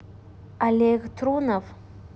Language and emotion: Russian, neutral